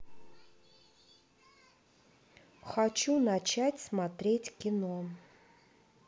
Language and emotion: Russian, neutral